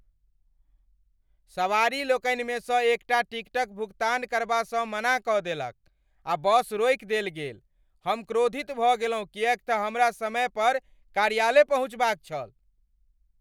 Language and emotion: Maithili, angry